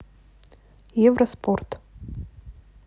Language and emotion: Russian, neutral